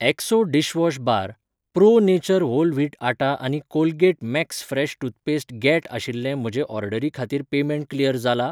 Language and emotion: Goan Konkani, neutral